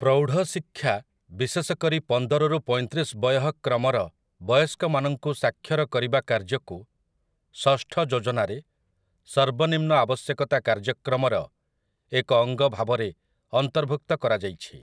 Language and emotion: Odia, neutral